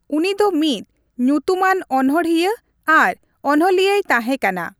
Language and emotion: Santali, neutral